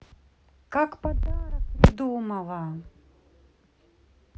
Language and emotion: Russian, neutral